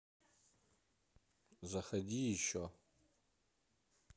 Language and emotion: Russian, neutral